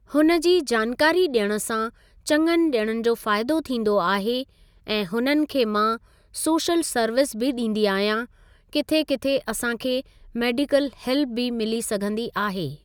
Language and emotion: Sindhi, neutral